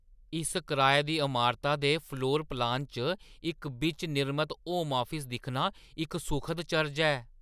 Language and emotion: Dogri, surprised